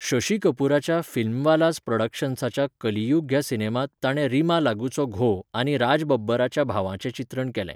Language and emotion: Goan Konkani, neutral